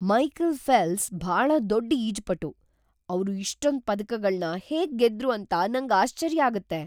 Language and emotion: Kannada, surprised